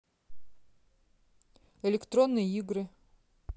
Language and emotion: Russian, neutral